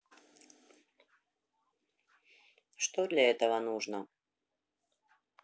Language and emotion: Russian, neutral